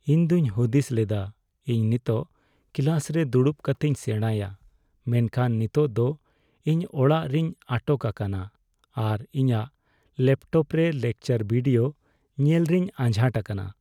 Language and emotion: Santali, sad